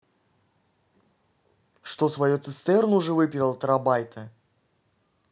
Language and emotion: Russian, angry